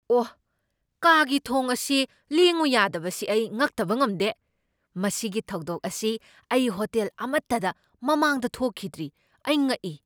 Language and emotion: Manipuri, surprised